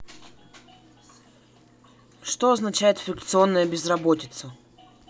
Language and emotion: Russian, neutral